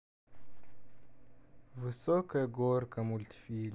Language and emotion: Russian, sad